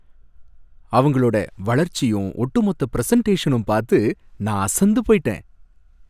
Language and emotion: Tamil, happy